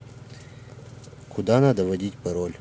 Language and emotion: Russian, neutral